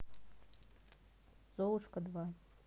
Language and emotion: Russian, neutral